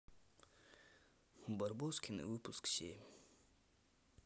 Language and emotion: Russian, sad